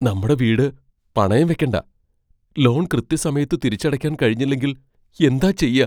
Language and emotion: Malayalam, fearful